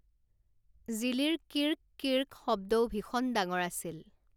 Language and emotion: Assamese, neutral